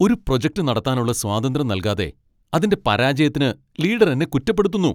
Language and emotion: Malayalam, angry